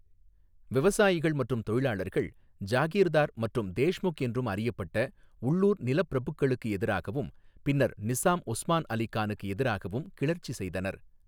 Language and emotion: Tamil, neutral